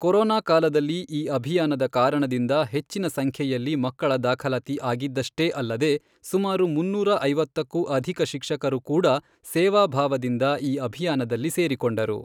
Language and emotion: Kannada, neutral